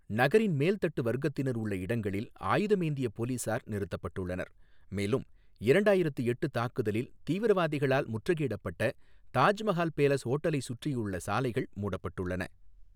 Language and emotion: Tamil, neutral